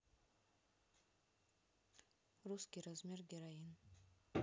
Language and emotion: Russian, neutral